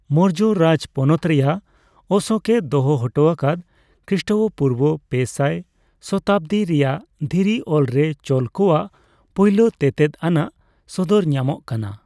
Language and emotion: Santali, neutral